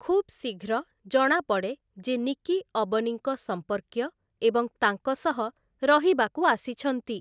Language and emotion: Odia, neutral